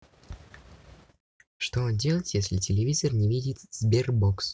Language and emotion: Russian, neutral